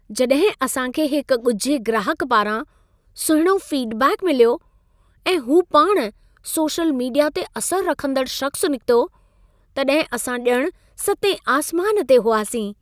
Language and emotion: Sindhi, happy